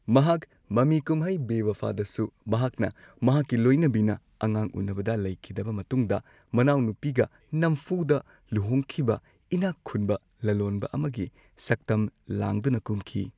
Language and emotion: Manipuri, neutral